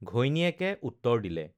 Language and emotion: Assamese, neutral